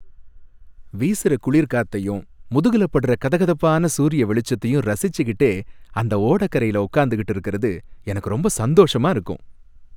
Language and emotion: Tamil, happy